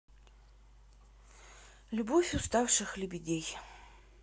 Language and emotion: Russian, sad